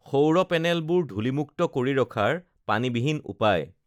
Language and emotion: Assamese, neutral